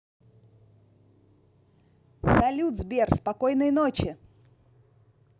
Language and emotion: Russian, positive